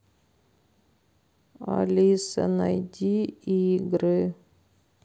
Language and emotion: Russian, sad